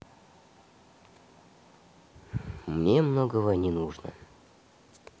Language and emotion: Russian, neutral